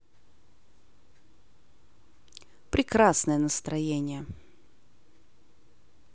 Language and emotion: Russian, positive